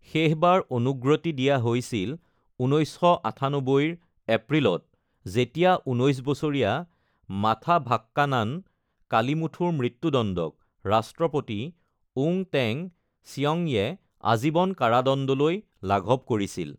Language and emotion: Assamese, neutral